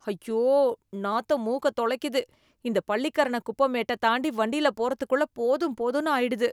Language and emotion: Tamil, disgusted